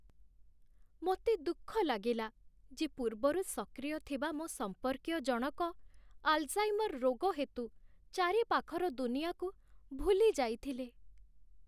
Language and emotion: Odia, sad